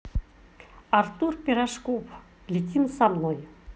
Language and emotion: Russian, positive